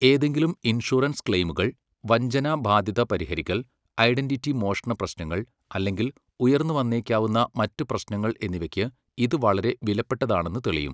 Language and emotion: Malayalam, neutral